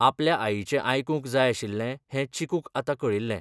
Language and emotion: Goan Konkani, neutral